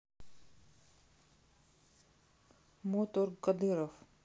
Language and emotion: Russian, neutral